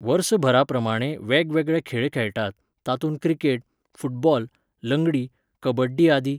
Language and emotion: Goan Konkani, neutral